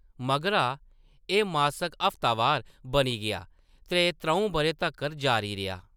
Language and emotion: Dogri, neutral